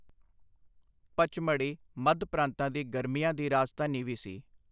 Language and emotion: Punjabi, neutral